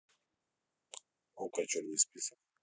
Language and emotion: Russian, neutral